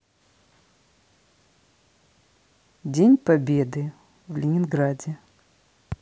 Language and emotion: Russian, neutral